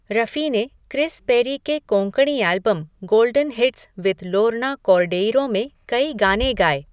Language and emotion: Hindi, neutral